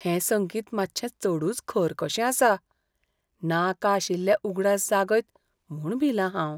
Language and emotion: Goan Konkani, fearful